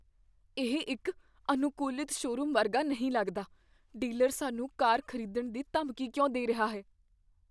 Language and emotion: Punjabi, fearful